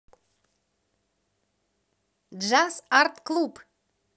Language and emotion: Russian, positive